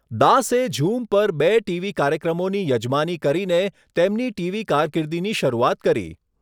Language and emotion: Gujarati, neutral